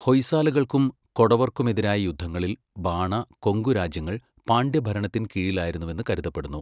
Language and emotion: Malayalam, neutral